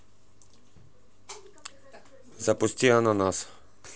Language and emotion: Russian, neutral